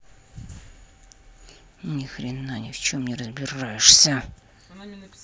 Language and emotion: Russian, angry